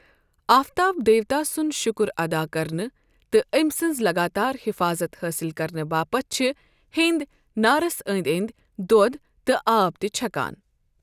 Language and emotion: Kashmiri, neutral